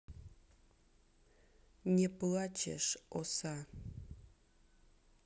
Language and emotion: Russian, angry